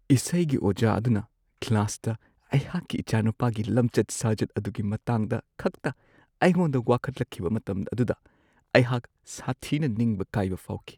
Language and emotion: Manipuri, sad